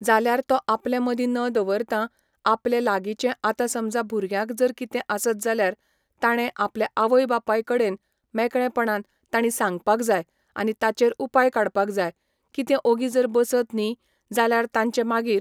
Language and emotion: Goan Konkani, neutral